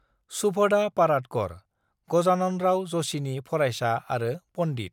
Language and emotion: Bodo, neutral